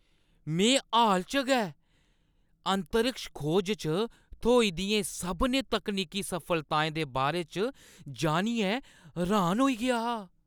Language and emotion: Dogri, surprised